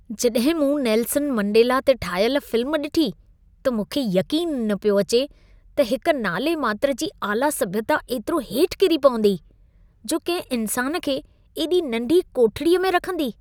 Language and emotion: Sindhi, disgusted